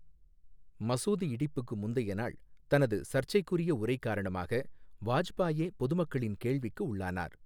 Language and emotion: Tamil, neutral